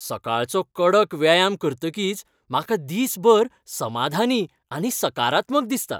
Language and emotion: Goan Konkani, happy